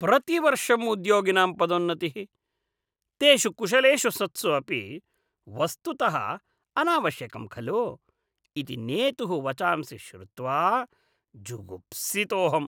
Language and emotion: Sanskrit, disgusted